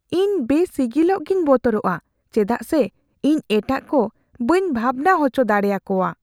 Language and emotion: Santali, fearful